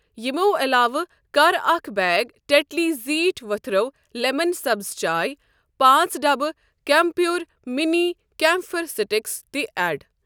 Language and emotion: Kashmiri, neutral